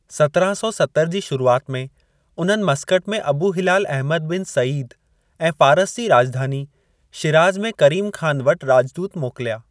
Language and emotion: Sindhi, neutral